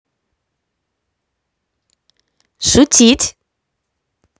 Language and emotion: Russian, positive